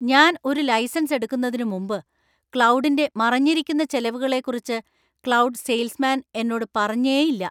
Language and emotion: Malayalam, angry